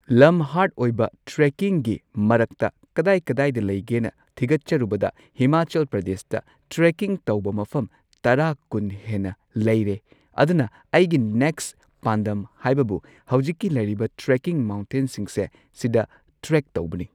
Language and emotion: Manipuri, neutral